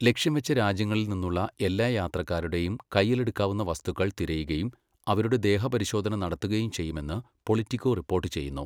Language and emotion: Malayalam, neutral